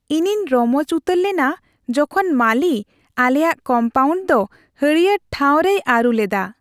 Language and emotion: Santali, happy